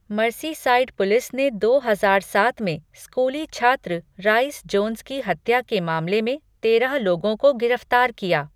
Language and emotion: Hindi, neutral